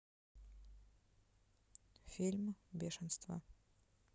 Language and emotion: Russian, neutral